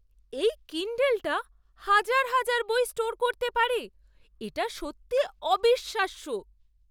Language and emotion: Bengali, surprised